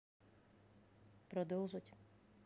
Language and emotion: Russian, neutral